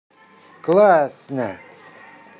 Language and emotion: Russian, positive